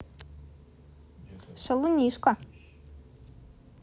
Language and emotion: Russian, positive